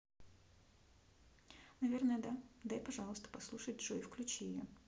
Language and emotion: Russian, neutral